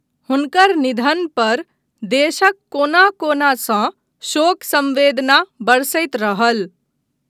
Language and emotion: Maithili, neutral